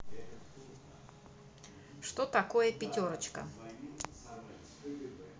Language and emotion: Russian, neutral